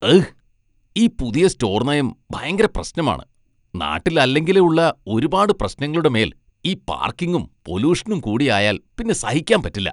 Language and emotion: Malayalam, disgusted